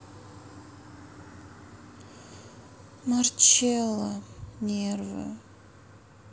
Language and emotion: Russian, sad